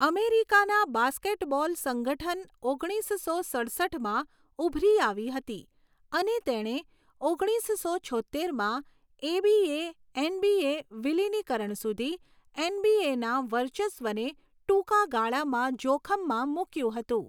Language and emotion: Gujarati, neutral